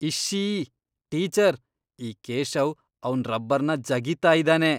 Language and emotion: Kannada, disgusted